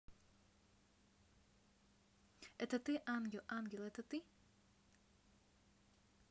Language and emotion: Russian, neutral